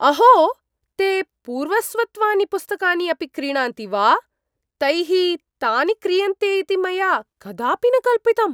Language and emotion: Sanskrit, surprised